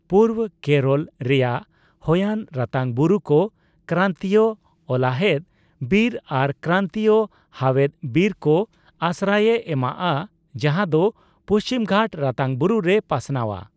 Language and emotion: Santali, neutral